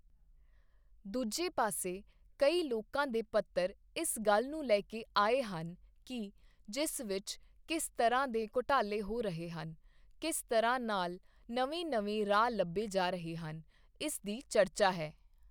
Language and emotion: Punjabi, neutral